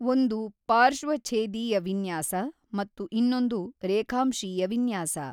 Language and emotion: Kannada, neutral